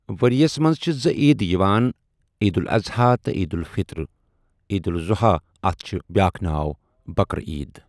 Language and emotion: Kashmiri, neutral